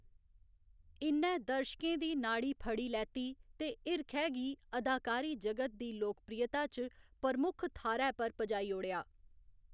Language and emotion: Dogri, neutral